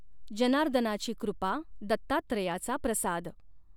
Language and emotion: Marathi, neutral